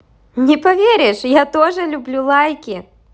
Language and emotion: Russian, positive